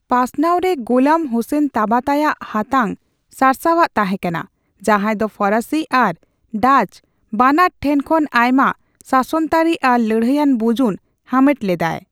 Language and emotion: Santali, neutral